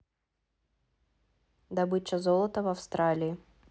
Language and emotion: Russian, neutral